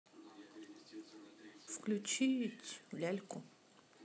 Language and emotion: Russian, neutral